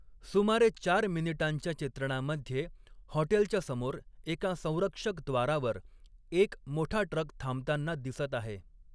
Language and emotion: Marathi, neutral